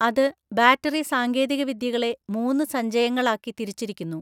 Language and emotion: Malayalam, neutral